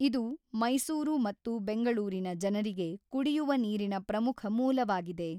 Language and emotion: Kannada, neutral